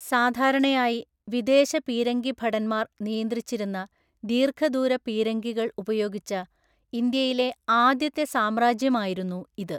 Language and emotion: Malayalam, neutral